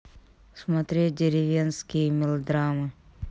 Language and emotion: Russian, neutral